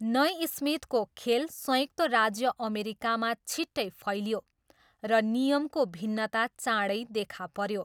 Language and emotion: Nepali, neutral